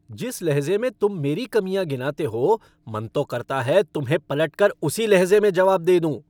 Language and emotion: Hindi, angry